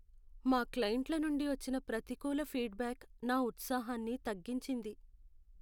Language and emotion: Telugu, sad